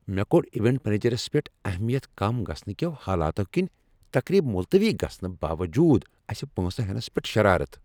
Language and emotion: Kashmiri, angry